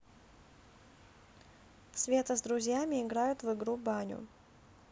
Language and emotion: Russian, neutral